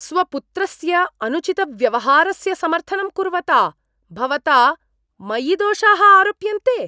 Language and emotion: Sanskrit, disgusted